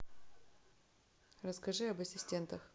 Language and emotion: Russian, neutral